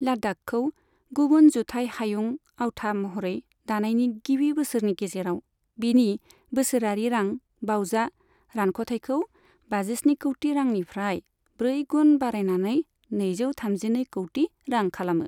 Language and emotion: Bodo, neutral